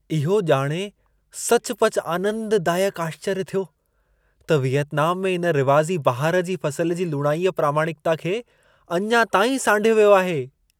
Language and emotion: Sindhi, surprised